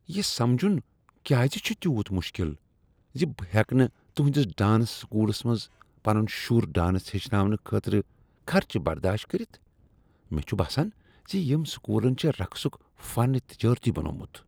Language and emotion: Kashmiri, disgusted